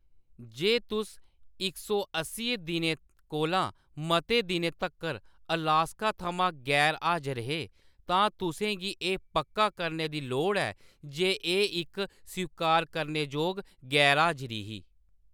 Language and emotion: Dogri, neutral